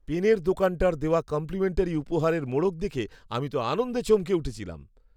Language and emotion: Bengali, surprised